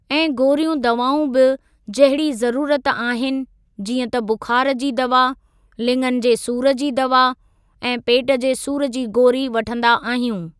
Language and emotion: Sindhi, neutral